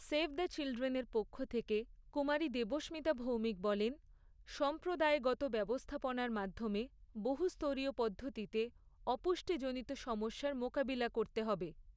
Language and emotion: Bengali, neutral